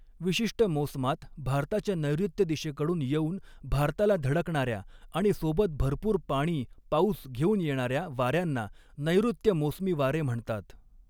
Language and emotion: Marathi, neutral